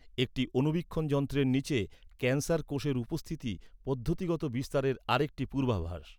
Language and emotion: Bengali, neutral